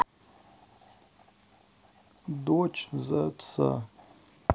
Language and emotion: Russian, sad